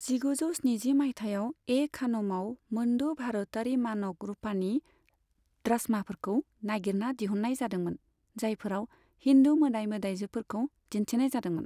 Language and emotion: Bodo, neutral